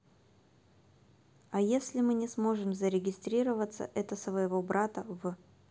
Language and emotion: Russian, neutral